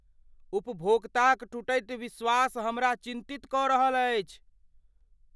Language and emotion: Maithili, fearful